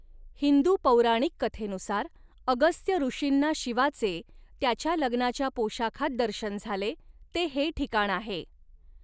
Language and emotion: Marathi, neutral